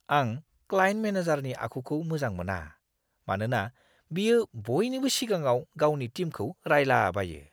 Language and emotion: Bodo, disgusted